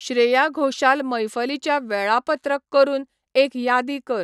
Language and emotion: Goan Konkani, neutral